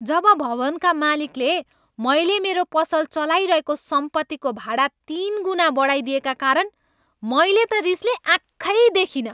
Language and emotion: Nepali, angry